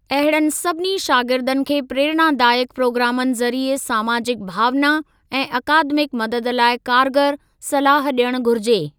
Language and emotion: Sindhi, neutral